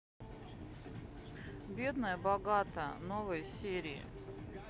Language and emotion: Russian, neutral